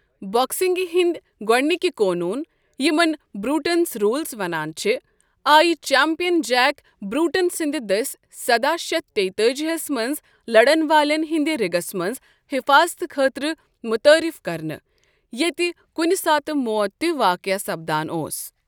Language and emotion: Kashmiri, neutral